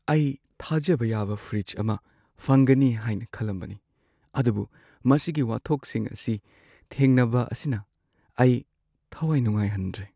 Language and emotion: Manipuri, sad